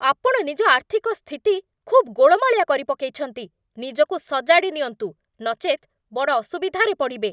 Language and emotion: Odia, angry